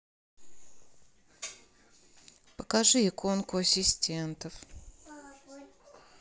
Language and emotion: Russian, neutral